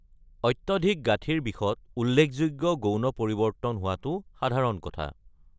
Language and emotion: Assamese, neutral